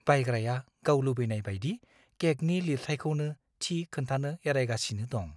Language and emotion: Bodo, fearful